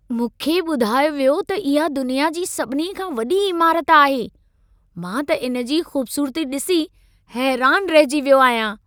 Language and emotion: Sindhi, surprised